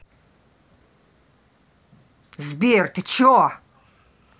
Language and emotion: Russian, angry